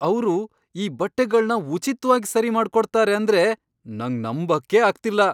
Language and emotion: Kannada, surprised